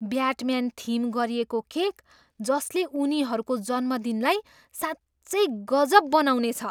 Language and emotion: Nepali, surprised